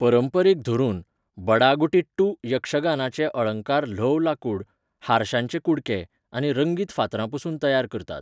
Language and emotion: Goan Konkani, neutral